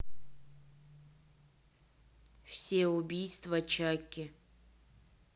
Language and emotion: Russian, neutral